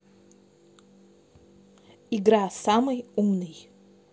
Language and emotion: Russian, neutral